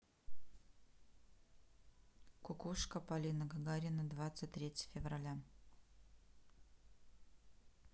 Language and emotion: Russian, neutral